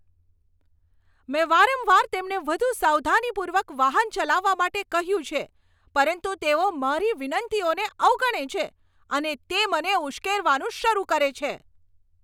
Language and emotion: Gujarati, angry